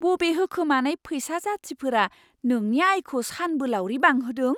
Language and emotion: Bodo, surprised